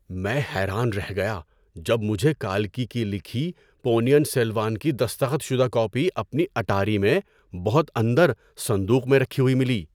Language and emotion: Urdu, surprised